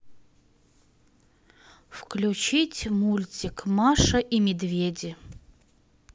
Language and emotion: Russian, neutral